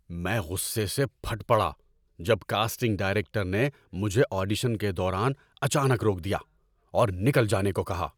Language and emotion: Urdu, angry